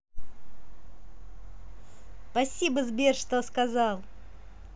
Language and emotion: Russian, positive